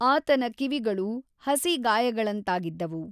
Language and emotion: Kannada, neutral